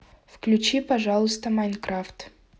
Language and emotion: Russian, neutral